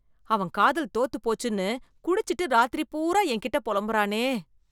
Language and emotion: Tamil, disgusted